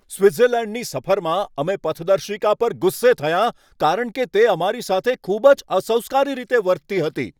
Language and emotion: Gujarati, angry